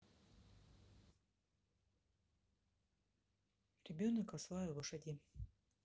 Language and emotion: Russian, neutral